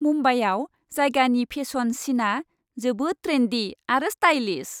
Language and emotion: Bodo, happy